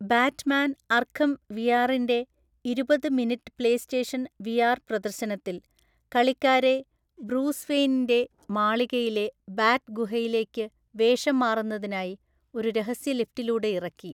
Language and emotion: Malayalam, neutral